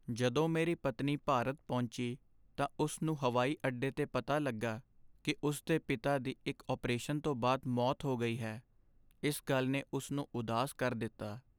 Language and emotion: Punjabi, sad